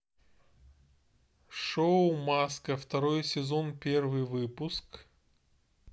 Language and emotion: Russian, neutral